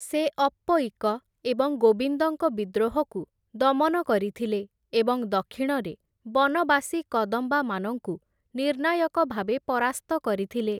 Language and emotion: Odia, neutral